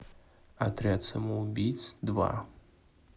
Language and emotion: Russian, neutral